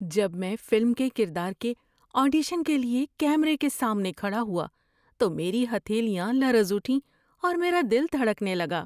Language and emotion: Urdu, fearful